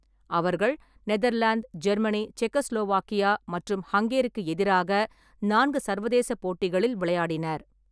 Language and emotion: Tamil, neutral